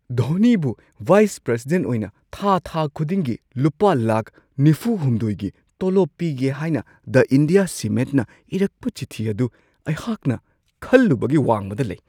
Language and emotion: Manipuri, surprised